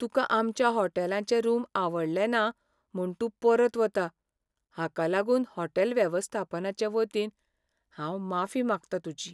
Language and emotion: Goan Konkani, sad